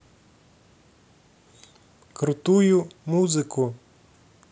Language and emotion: Russian, neutral